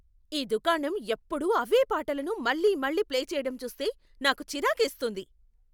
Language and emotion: Telugu, angry